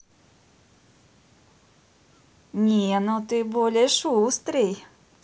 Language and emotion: Russian, positive